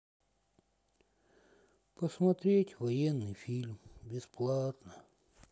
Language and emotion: Russian, sad